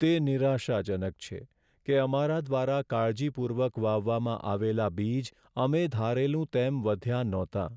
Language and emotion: Gujarati, sad